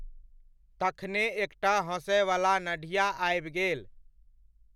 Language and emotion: Maithili, neutral